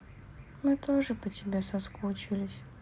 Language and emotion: Russian, sad